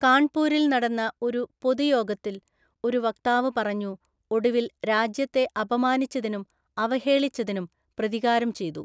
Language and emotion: Malayalam, neutral